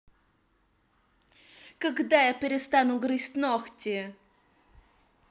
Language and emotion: Russian, angry